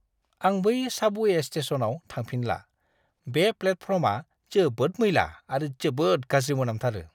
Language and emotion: Bodo, disgusted